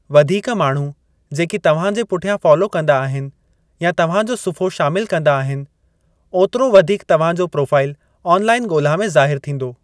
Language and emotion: Sindhi, neutral